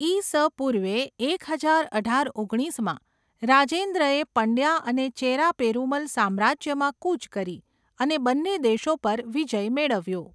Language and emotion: Gujarati, neutral